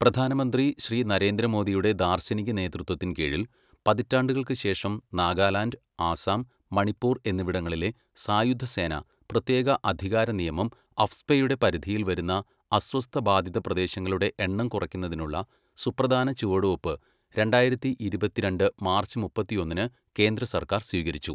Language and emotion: Malayalam, neutral